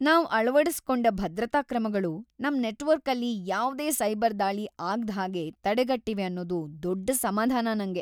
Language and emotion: Kannada, happy